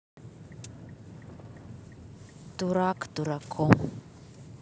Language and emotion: Russian, sad